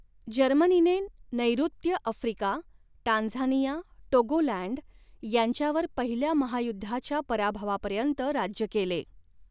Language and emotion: Marathi, neutral